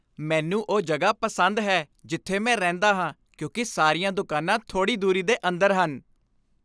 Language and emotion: Punjabi, happy